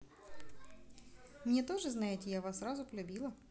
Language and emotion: Russian, positive